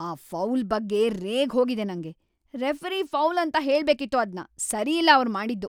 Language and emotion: Kannada, angry